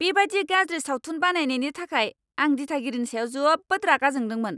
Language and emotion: Bodo, angry